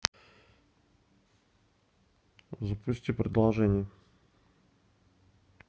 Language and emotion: Russian, neutral